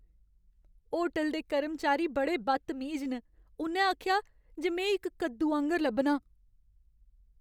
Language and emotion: Dogri, sad